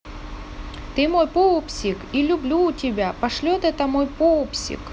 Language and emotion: Russian, positive